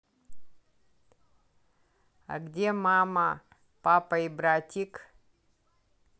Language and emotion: Russian, neutral